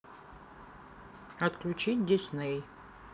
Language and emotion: Russian, neutral